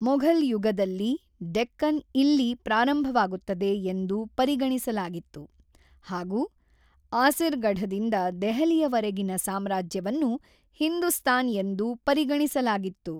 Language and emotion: Kannada, neutral